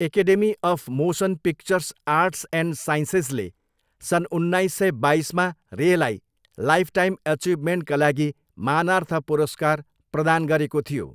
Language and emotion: Nepali, neutral